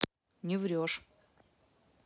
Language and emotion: Russian, neutral